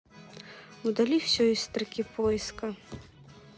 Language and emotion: Russian, neutral